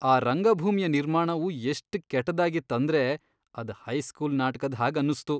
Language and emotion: Kannada, disgusted